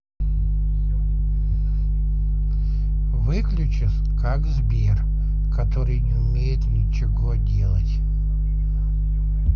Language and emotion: Russian, neutral